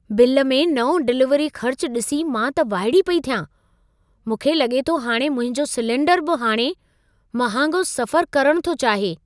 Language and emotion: Sindhi, surprised